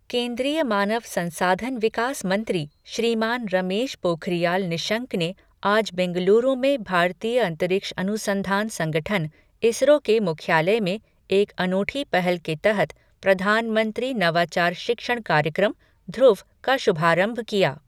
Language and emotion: Hindi, neutral